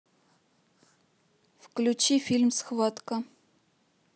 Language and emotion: Russian, neutral